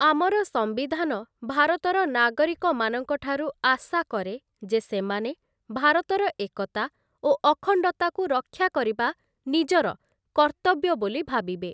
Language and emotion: Odia, neutral